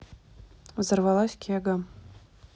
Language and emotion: Russian, neutral